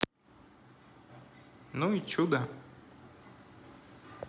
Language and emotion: Russian, neutral